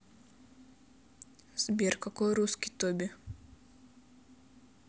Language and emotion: Russian, neutral